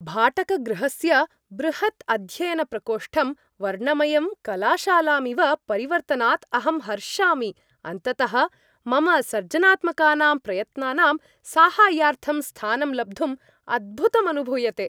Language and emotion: Sanskrit, happy